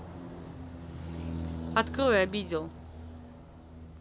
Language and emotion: Russian, neutral